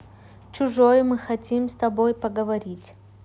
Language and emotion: Russian, neutral